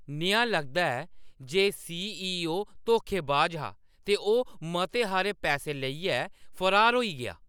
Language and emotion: Dogri, angry